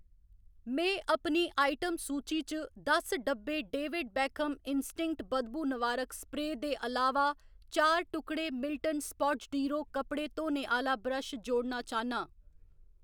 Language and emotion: Dogri, neutral